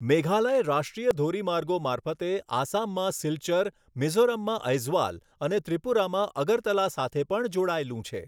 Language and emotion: Gujarati, neutral